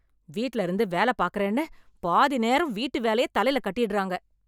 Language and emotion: Tamil, angry